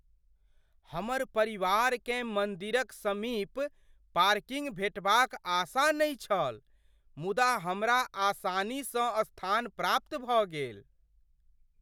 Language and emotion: Maithili, surprised